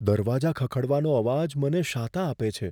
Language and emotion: Gujarati, fearful